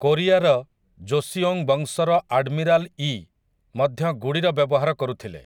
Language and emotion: Odia, neutral